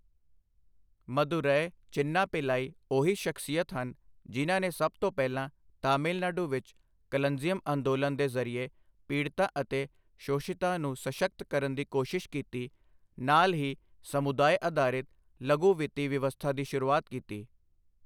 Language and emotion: Punjabi, neutral